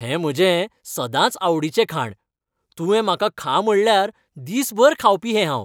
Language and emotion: Goan Konkani, happy